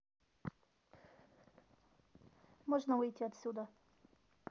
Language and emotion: Russian, neutral